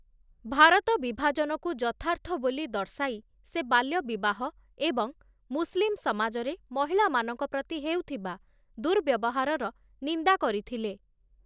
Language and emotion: Odia, neutral